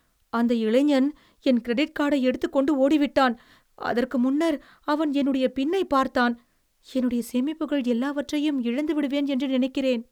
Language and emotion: Tamil, fearful